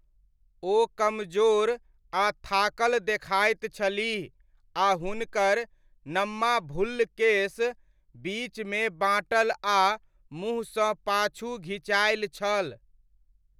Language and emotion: Maithili, neutral